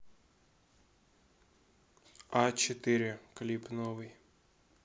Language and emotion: Russian, neutral